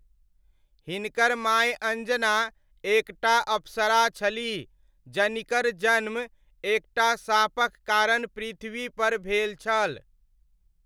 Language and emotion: Maithili, neutral